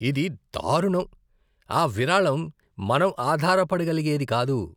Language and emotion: Telugu, disgusted